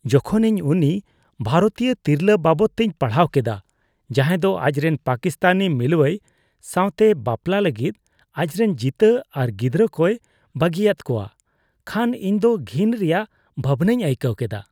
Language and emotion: Santali, disgusted